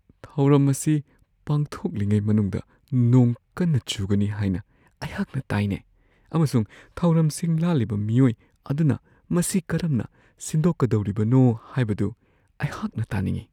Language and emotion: Manipuri, fearful